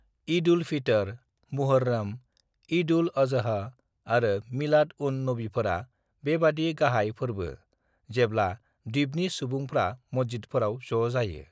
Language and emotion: Bodo, neutral